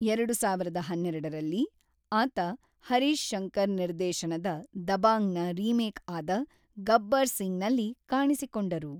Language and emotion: Kannada, neutral